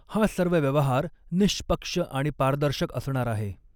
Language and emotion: Marathi, neutral